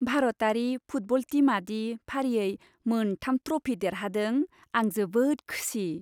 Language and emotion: Bodo, happy